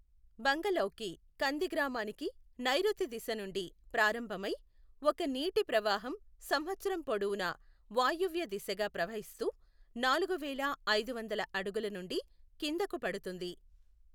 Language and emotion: Telugu, neutral